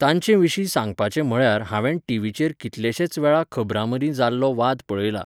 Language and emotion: Goan Konkani, neutral